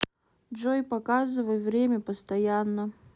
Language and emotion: Russian, neutral